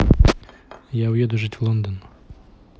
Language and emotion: Russian, neutral